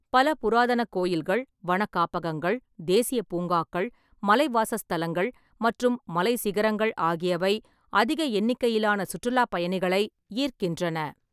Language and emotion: Tamil, neutral